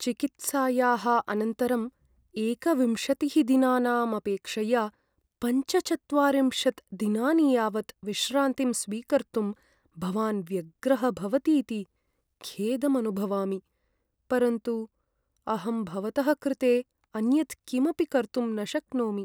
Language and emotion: Sanskrit, sad